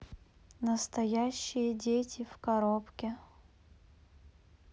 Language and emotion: Russian, neutral